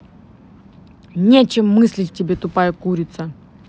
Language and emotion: Russian, angry